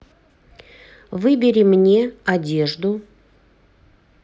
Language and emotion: Russian, neutral